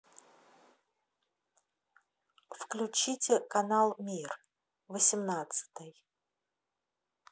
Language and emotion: Russian, neutral